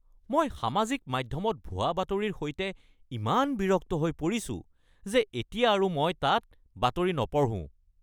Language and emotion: Assamese, angry